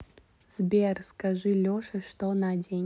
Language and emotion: Russian, neutral